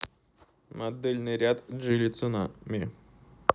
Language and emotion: Russian, neutral